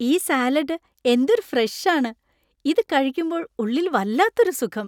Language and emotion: Malayalam, happy